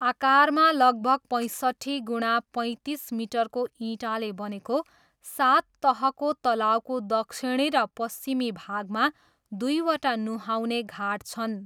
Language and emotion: Nepali, neutral